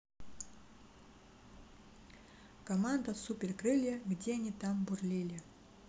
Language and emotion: Russian, neutral